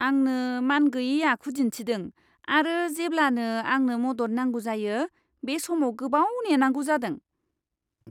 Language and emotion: Bodo, disgusted